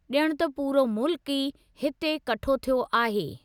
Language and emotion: Sindhi, neutral